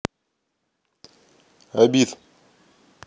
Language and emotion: Russian, neutral